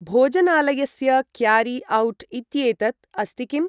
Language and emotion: Sanskrit, neutral